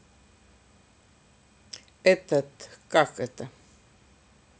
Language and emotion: Russian, neutral